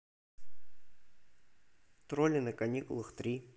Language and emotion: Russian, neutral